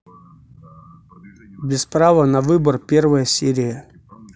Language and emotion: Russian, neutral